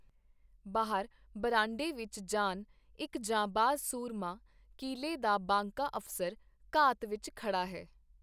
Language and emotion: Punjabi, neutral